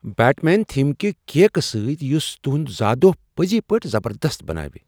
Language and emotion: Kashmiri, surprised